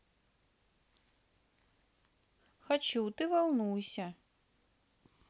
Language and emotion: Russian, neutral